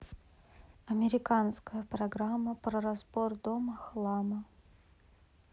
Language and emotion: Russian, neutral